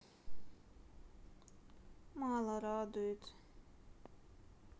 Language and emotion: Russian, sad